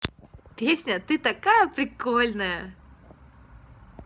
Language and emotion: Russian, positive